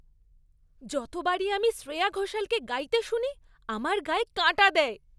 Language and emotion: Bengali, happy